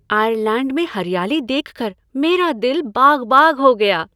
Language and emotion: Hindi, happy